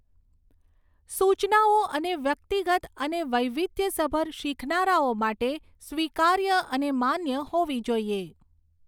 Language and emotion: Gujarati, neutral